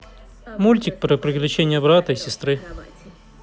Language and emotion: Russian, neutral